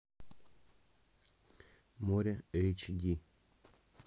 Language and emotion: Russian, neutral